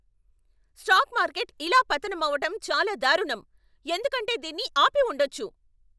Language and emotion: Telugu, angry